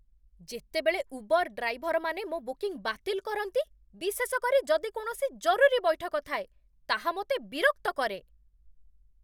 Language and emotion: Odia, angry